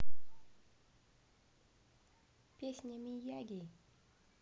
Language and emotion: Russian, neutral